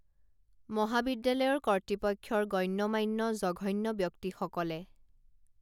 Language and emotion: Assamese, neutral